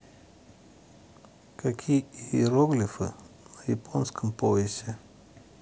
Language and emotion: Russian, neutral